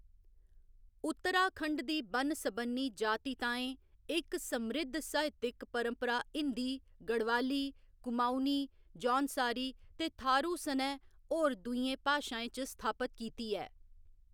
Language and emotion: Dogri, neutral